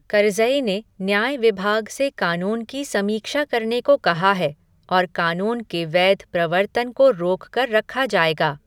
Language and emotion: Hindi, neutral